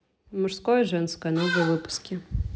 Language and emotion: Russian, neutral